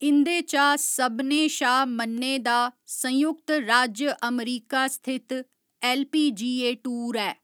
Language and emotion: Dogri, neutral